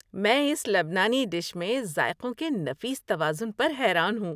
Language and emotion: Urdu, happy